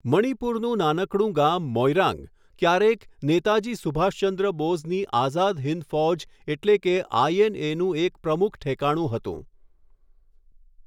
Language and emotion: Gujarati, neutral